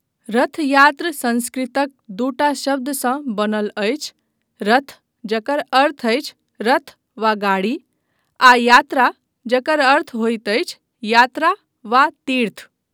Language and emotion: Maithili, neutral